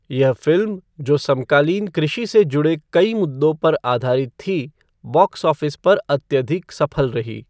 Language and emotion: Hindi, neutral